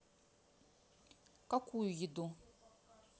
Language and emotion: Russian, neutral